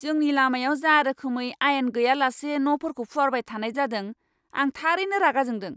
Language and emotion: Bodo, angry